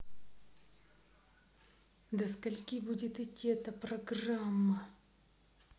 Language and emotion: Russian, angry